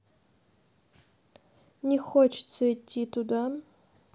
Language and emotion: Russian, sad